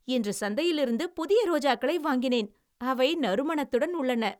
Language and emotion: Tamil, happy